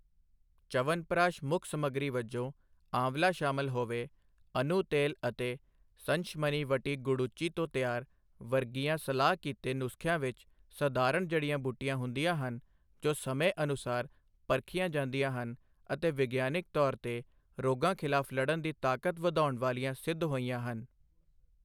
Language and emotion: Punjabi, neutral